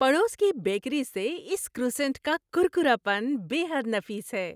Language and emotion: Urdu, happy